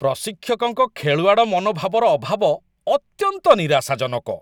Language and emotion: Odia, disgusted